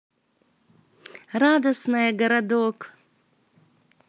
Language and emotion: Russian, positive